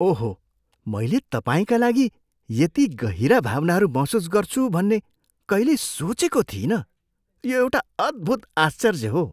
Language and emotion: Nepali, surprised